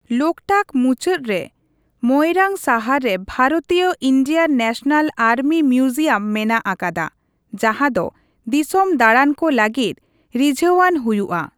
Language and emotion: Santali, neutral